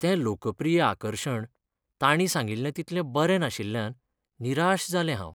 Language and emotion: Goan Konkani, sad